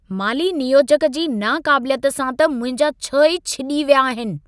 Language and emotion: Sindhi, angry